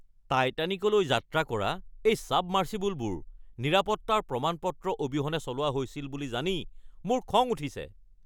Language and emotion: Assamese, angry